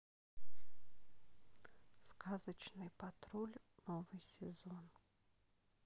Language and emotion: Russian, neutral